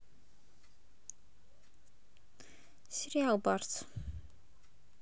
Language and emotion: Russian, neutral